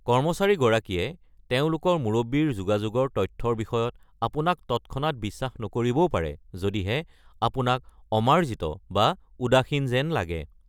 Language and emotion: Assamese, neutral